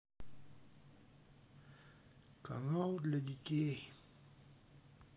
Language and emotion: Russian, sad